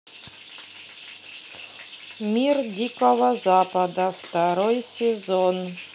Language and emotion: Russian, neutral